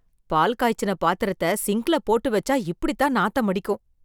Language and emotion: Tamil, disgusted